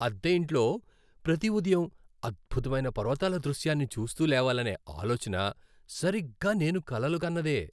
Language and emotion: Telugu, happy